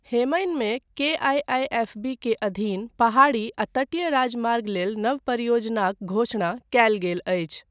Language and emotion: Maithili, neutral